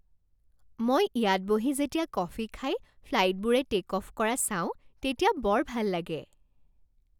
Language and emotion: Assamese, happy